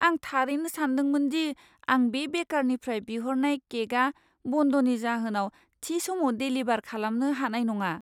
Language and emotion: Bodo, fearful